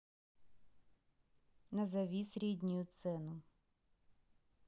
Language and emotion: Russian, neutral